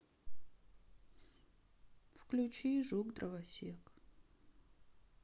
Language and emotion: Russian, sad